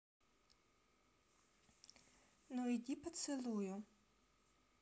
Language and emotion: Russian, neutral